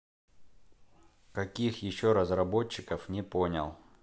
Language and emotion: Russian, neutral